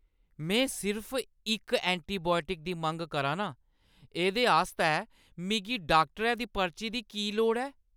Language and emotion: Dogri, angry